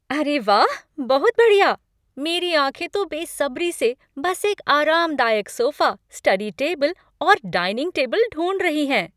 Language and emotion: Hindi, happy